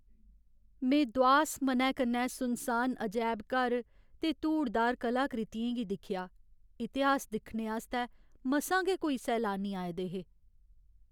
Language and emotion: Dogri, sad